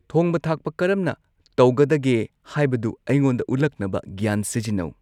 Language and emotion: Manipuri, neutral